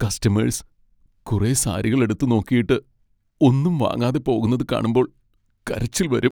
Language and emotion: Malayalam, sad